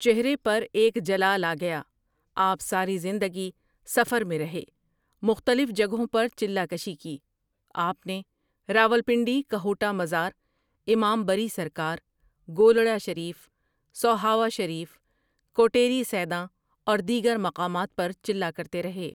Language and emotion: Urdu, neutral